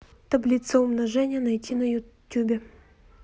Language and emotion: Russian, neutral